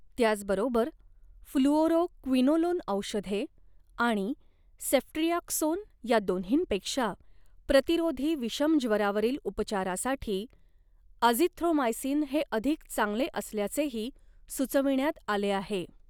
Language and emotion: Marathi, neutral